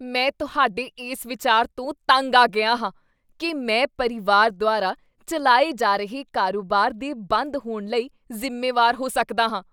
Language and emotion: Punjabi, disgusted